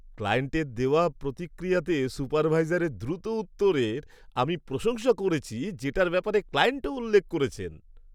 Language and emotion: Bengali, happy